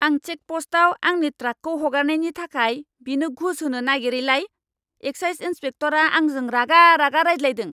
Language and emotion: Bodo, angry